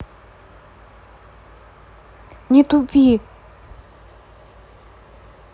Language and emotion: Russian, angry